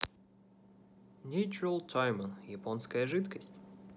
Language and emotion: Russian, neutral